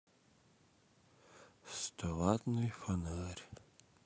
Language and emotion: Russian, sad